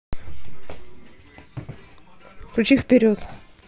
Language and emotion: Russian, neutral